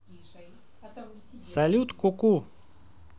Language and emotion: Russian, positive